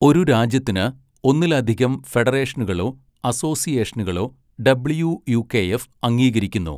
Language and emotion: Malayalam, neutral